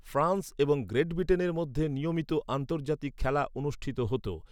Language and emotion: Bengali, neutral